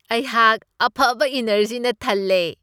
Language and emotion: Manipuri, happy